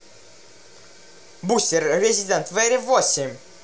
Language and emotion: Russian, neutral